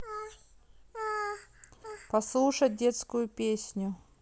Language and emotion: Russian, neutral